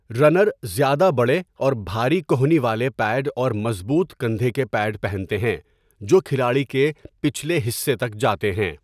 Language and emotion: Urdu, neutral